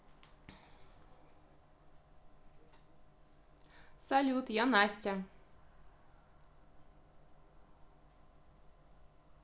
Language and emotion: Russian, positive